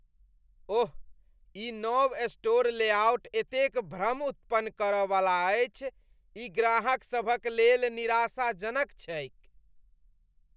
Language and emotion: Maithili, disgusted